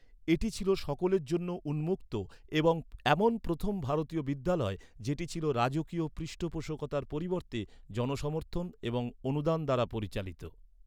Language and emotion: Bengali, neutral